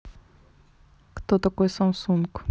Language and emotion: Russian, neutral